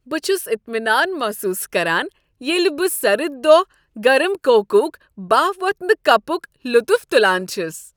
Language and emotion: Kashmiri, happy